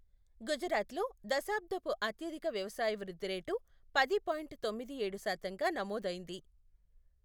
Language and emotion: Telugu, neutral